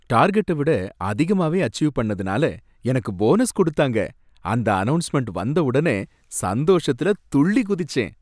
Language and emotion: Tamil, happy